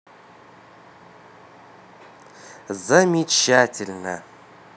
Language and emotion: Russian, positive